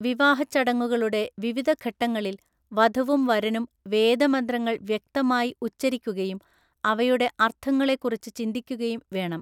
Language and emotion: Malayalam, neutral